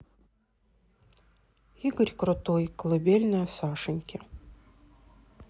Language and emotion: Russian, neutral